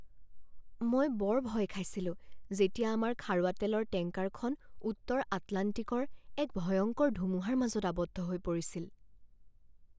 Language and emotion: Assamese, fearful